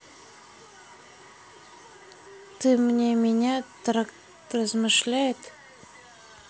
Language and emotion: Russian, neutral